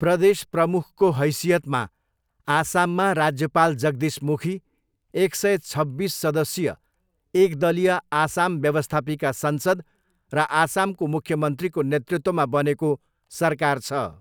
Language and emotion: Nepali, neutral